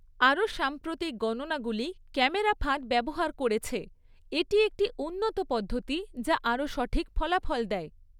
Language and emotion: Bengali, neutral